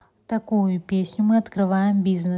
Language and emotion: Russian, neutral